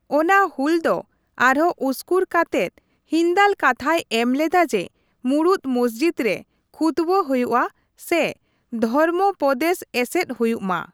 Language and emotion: Santali, neutral